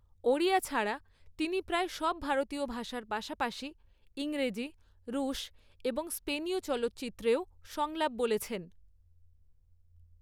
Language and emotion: Bengali, neutral